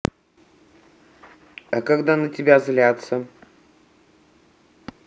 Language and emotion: Russian, neutral